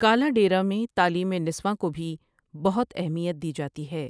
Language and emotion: Urdu, neutral